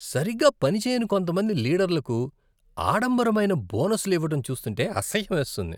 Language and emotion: Telugu, disgusted